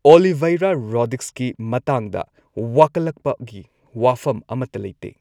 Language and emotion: Manipuri, neutral